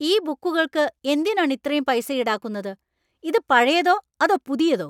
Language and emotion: Malayalam, angry